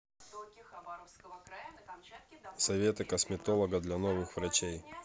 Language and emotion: Russian, neutral